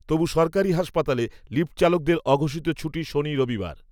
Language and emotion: Bengali, neutral